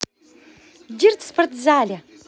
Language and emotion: Russian, positive